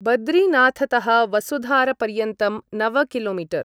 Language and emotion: Sanskrit, neutral